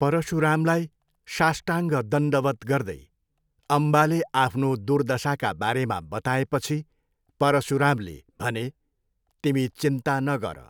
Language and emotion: Nepali, neutral